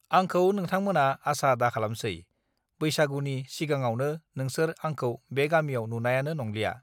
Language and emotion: Bodo, neutral